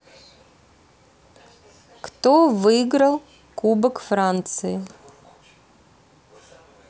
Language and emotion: Russian, neutral